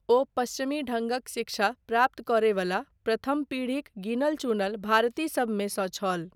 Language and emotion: Maithili, neutral